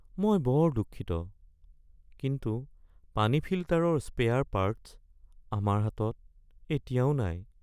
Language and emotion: Assamese, sad